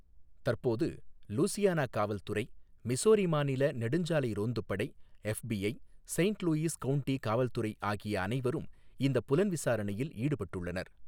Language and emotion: Tamil, neutral